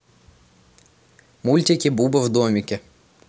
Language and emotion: Russian, neutral